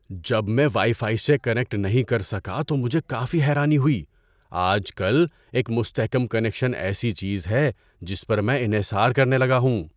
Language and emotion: Urdu, surprised